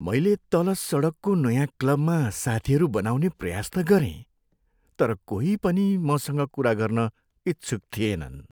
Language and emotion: Nepali, sad